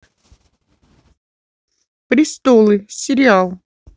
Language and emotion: Russian, neutral